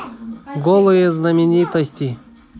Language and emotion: Russian, neutral